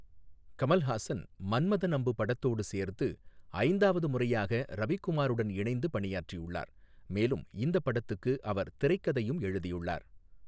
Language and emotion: Tamil, neutral